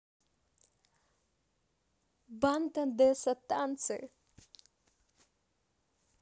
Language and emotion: Russian, positive